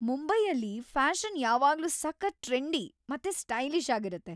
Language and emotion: Kannada, happy